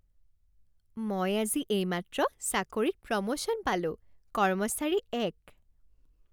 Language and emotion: Assamese, happy